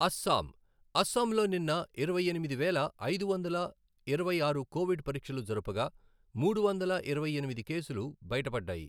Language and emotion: Telugu, neutral